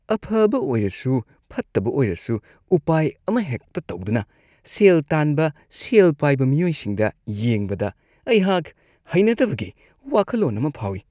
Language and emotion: Manipuri, disgusted